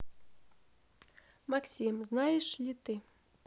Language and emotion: Russian, neutral